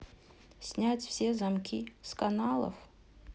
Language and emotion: Russian, neutral